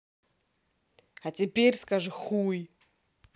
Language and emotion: Russian, angry